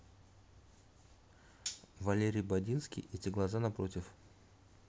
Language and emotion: Russian, neutral